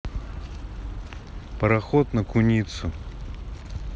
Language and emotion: Russian, neutral